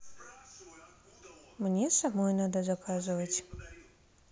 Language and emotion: Russian, neutral